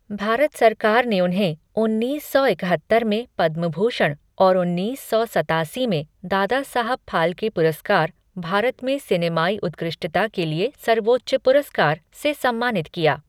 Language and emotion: Hindi, neutral